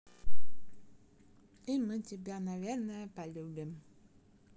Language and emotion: Russian, positive